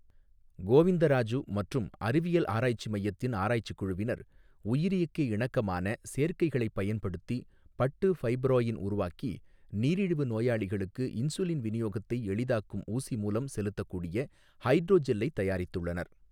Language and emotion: Tamil, neutral